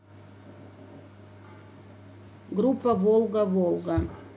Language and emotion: Russian, neutral